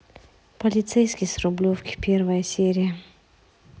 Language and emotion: Russian, neutral